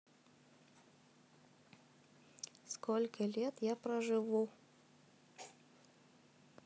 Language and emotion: Russian, neutral